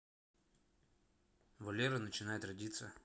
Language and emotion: Russian, neutral